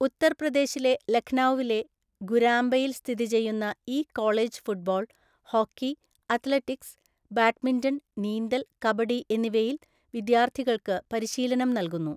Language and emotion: Malayalam, neutral